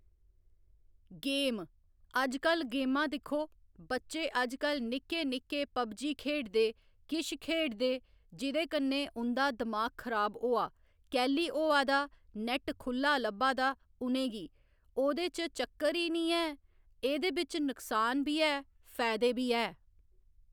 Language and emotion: Dogri, neutral